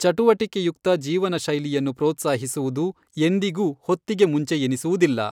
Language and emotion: Kannada, neutral